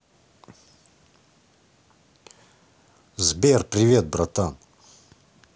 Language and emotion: Russian, positive